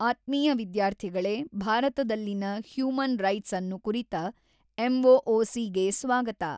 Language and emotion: Kannada, neutral